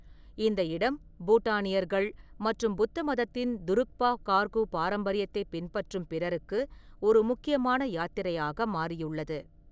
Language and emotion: Tamil, neutral